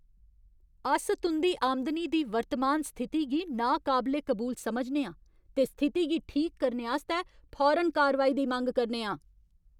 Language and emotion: Dogri, angry